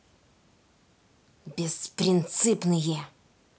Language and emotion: Russian, angry